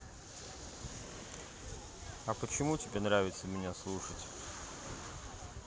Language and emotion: Russian, neutral